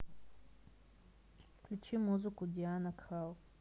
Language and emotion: Russian, neutral